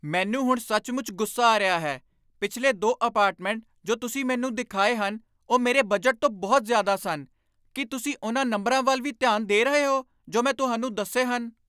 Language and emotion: Punjabi, angry